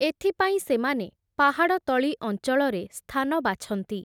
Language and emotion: Odia, neutral